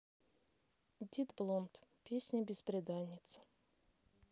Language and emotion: Russian, neutral